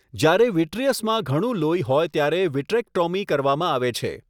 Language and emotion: Gujarati, neutral